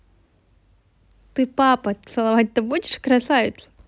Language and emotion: Russian, positive